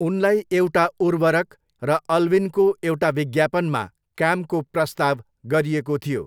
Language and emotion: Nepali, neutral